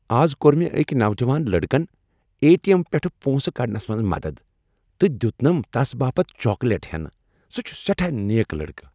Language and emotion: Kashmiri, happy